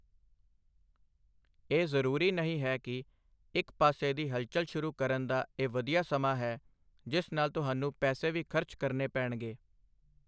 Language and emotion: Punjabi, neutral